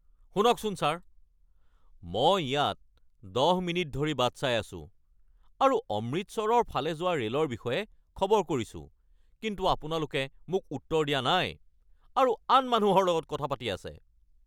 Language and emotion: Assamese, angry